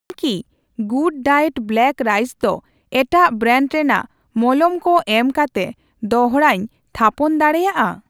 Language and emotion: Santali, neutral